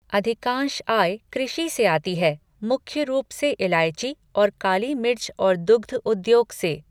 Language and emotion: Hindi, neutral